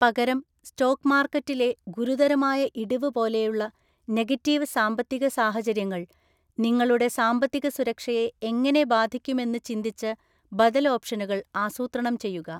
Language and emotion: Malayalam, neutral